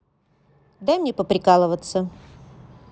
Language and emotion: Russian, neutral